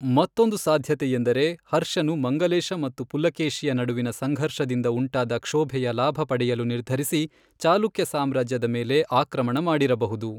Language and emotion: Kannada, neutral